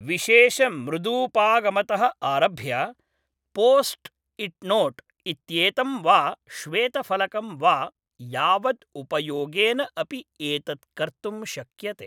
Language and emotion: Sanskrit, neutral